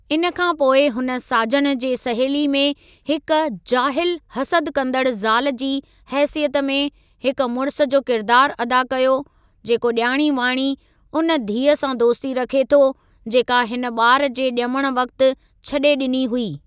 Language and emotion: Sindhi, neutral